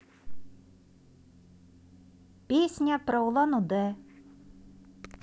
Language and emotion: Russian, positive